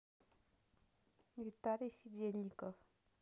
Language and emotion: Russian, neutral